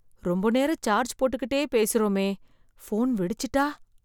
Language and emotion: Tamil, fearful